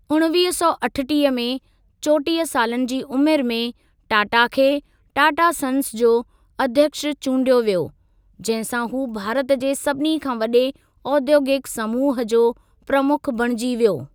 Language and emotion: Sindhi, neutral